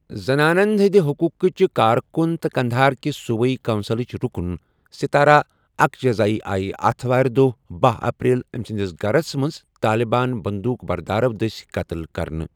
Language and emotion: Kashmiri, neutral